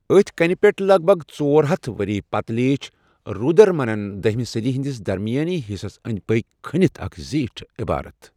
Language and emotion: Kashmiri, neutral